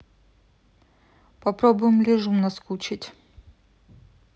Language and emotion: Russian, neutral